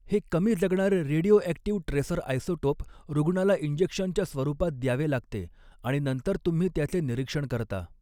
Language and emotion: Marathi, neutral